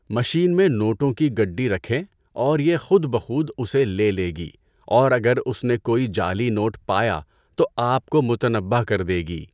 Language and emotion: Urdu, neutral